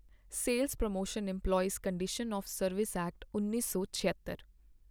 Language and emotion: Punjabi, neutral